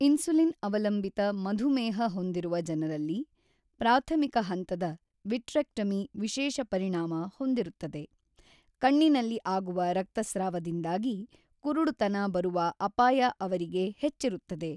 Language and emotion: Kannada, neutral